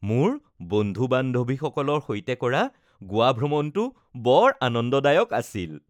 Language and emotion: Assamese, happy